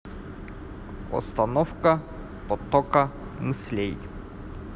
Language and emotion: Russian, neutral